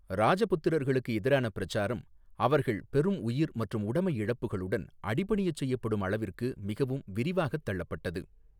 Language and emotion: Tamil, neutral